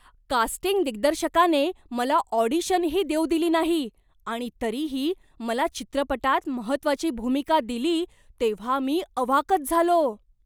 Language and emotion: Marathi, surprised